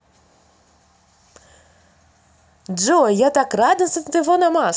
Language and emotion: Russian, positive